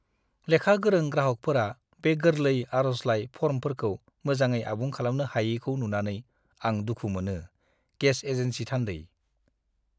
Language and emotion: Bodo, disgusted